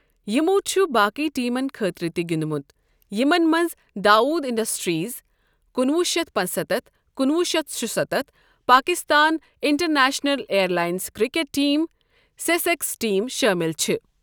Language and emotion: Kashmiri, neutral